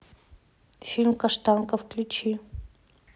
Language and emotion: Russian, neutral